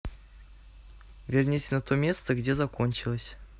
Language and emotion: Russian, neutral